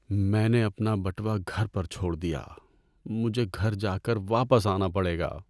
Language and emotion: Urdu, sad